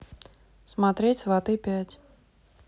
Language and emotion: Russian, neutral